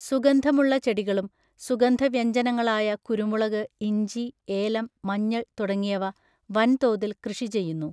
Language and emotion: Malayalam, neutral